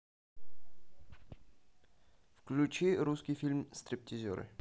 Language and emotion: Russian, neutral